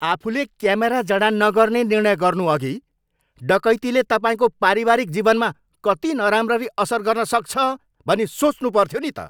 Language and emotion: Nepali, angry